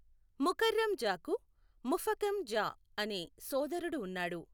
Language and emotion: Telugu, neutral